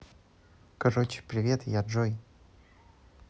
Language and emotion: Russian, neutral